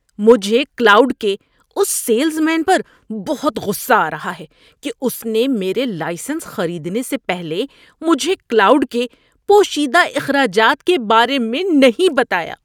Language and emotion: Urdu, angry